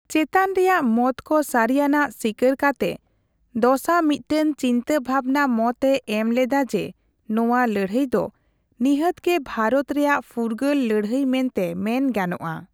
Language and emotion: Santali, neutral